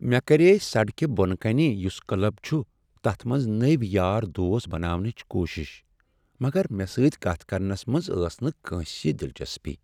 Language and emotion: Kashmiri, sad